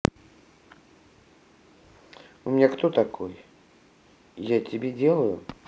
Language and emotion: Russian, angry